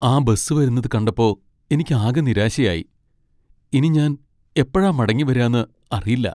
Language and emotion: Malayalam, sad